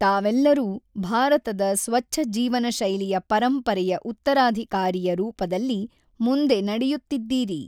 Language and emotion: Kannada, neutral